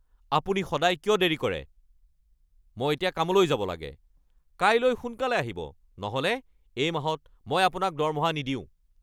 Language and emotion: Assamese, angry